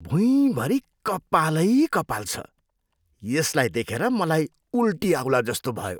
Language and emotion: Nepali, disgusted